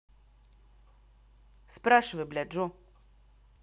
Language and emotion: Russian, angry